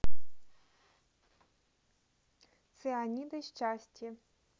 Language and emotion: Russian, neutral